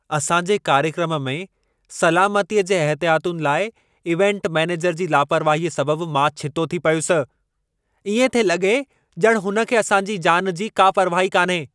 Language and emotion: Sindhi, angry